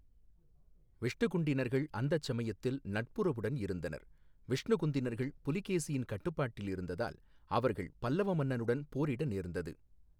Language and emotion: Tamil, neutral